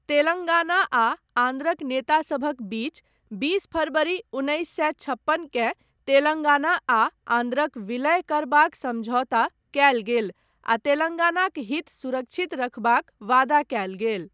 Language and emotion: Maithili, neutral